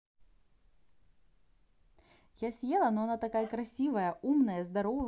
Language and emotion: Russian, positive